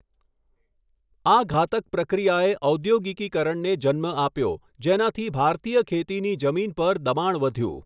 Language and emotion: Gujarati, neutral